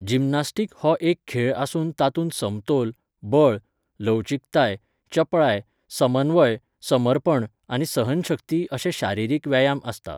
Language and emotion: Goan Konkani, neutral